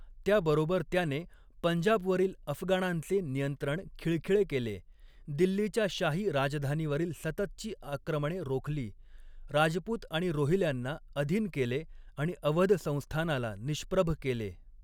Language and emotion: Marathi, neutral